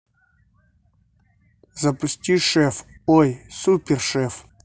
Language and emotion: Russian, neutral